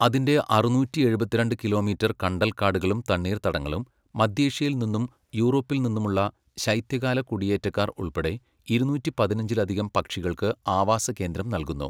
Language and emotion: Malayalam, neutral